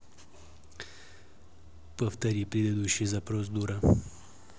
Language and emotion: Russian, neutral